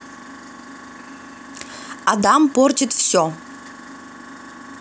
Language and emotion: Russian, positive